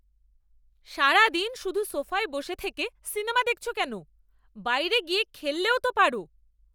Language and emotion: Bengali, angry